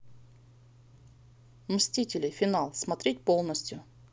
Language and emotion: Russian, neutral